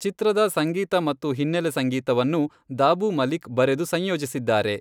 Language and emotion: Kannada, neutral